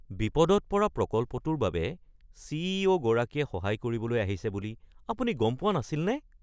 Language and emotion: Assamese, surprised